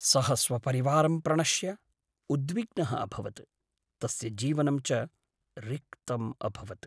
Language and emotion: Sanskrit, sad